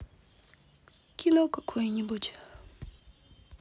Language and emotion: Russian, sad